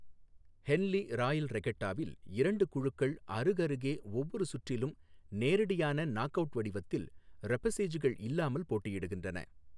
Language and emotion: Tamil, neutral